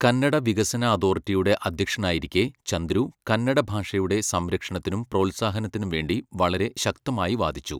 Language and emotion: Malayalam, neutral